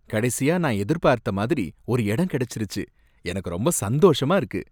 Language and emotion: Tamil, happy